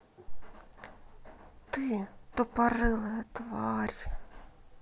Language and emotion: Russian, angry